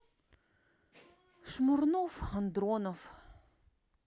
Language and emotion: Russian, sad